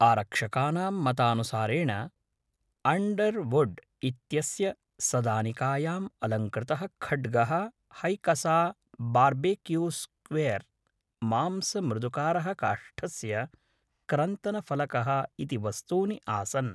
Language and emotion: Sanskrit, neutral